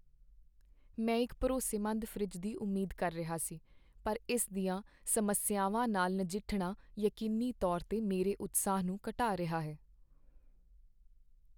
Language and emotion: Punjabi, sad